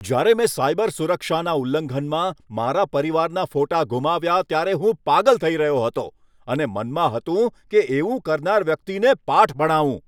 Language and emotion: Gujarati, angry